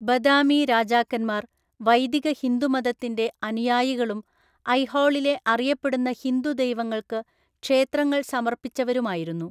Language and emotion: Malayalam, neutral